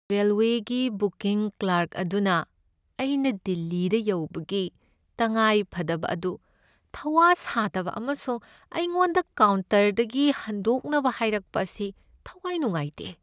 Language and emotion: Manipuri, sad